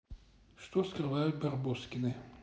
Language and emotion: Russian, neutral